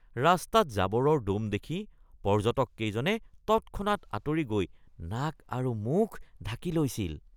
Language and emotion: Assamese, disgusted